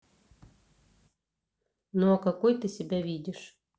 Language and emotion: Russian, neutral